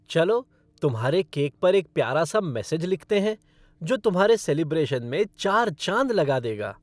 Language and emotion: Hindi, happy